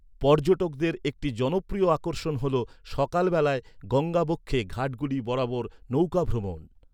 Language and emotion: Bengali, neutral